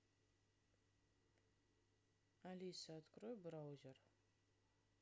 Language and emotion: Russian, neutral